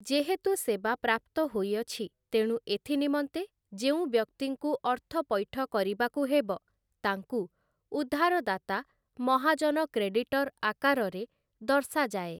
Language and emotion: Odia, neutral